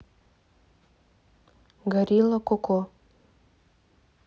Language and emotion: Russian, neutral